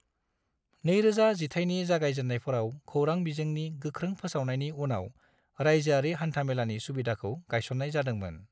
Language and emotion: Bodo, neutral